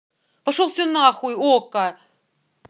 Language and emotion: Russian, angry